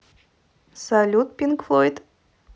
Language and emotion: Russian, positive